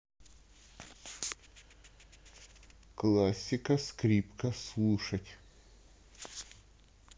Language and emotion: Russian, neutral